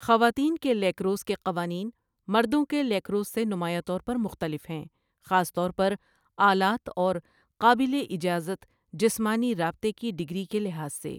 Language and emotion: Urdu, neutral